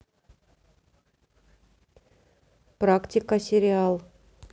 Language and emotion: Russian, neutral